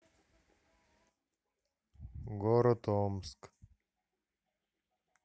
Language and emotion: Russian, neutral